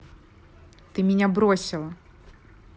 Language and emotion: Russian, angry